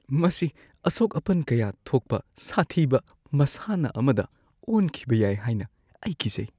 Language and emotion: Manipuri, fearful